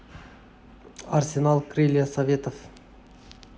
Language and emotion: Russian, neutral